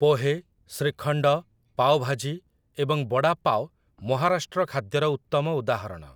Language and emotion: Odia, neutral